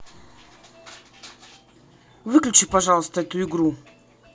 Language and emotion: Russian, angry